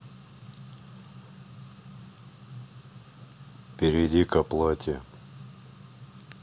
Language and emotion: Russian, neutral